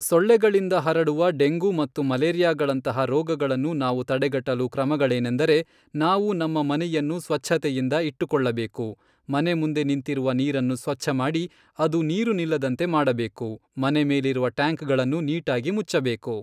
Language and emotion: Kannada, neutral